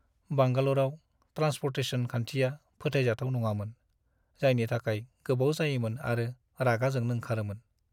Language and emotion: Bodo, sad